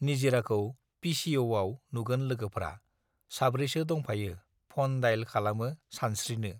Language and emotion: Bodo, neutral